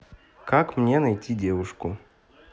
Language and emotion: Russian, neutral